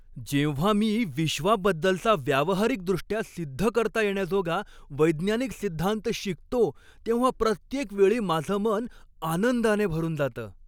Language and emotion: Marathi, happy